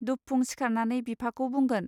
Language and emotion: Bodo, neutral